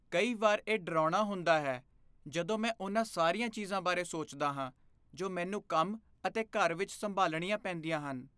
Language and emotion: Punjabi, fearful